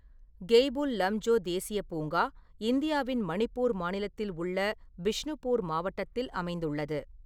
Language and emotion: Tamil, neutral